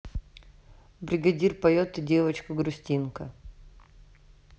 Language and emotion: Russian, neutral